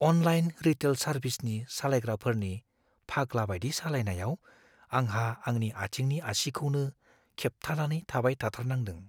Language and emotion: Bodo, fearful